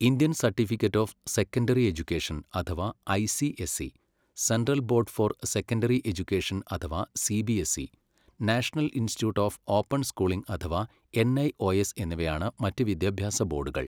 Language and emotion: Malayalam, neutral